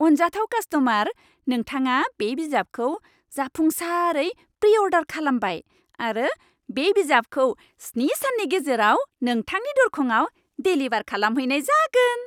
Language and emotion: Bodo, happy